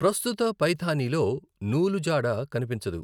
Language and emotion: Telugu, neutral